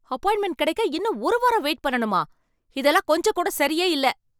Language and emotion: Tamil, angry